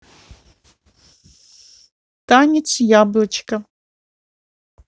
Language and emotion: Russian, positive